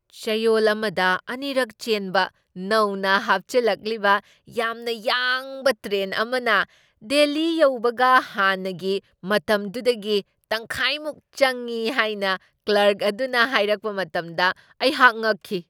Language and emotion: Manipuri, surprised